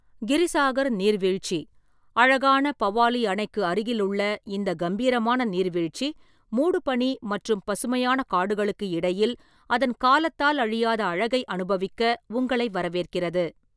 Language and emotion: Tamil, neutral